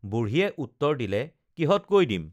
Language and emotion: Assamese, neutral